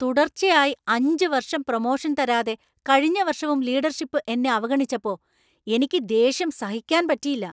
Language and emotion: Malayalam, angry